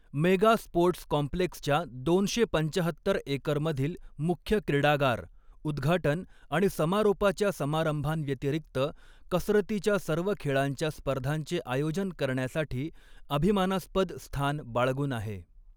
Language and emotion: Marathi, neutral